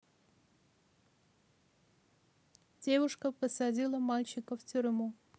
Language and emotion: Russian, neutral